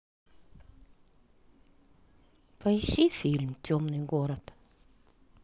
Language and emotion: Russian, sad